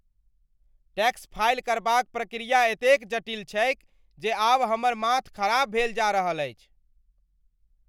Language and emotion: Maithili, angry